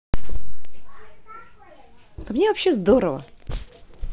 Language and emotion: Russian, positive